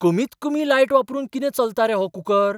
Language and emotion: Goan Konkani, surprised